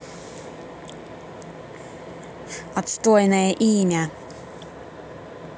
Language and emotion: Russian, angry